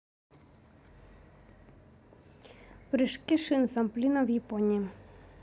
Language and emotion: Russian, neutral